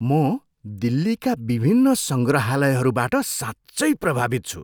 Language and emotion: Nepali, surprised